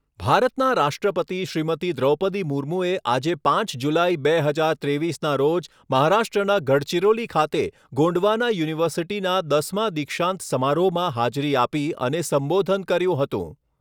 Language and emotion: Gujarati, neutral